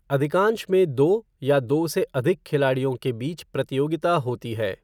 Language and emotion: Hindi, neutral